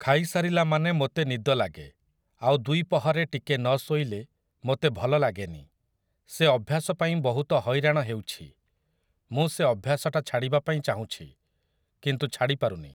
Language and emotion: Odia, neutral